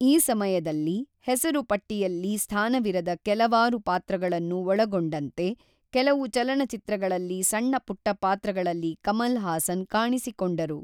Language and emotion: Kannada, neutral